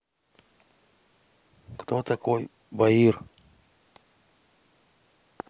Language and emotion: Russian, neutral